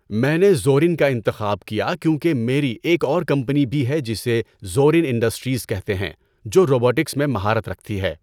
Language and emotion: Urdu, neutral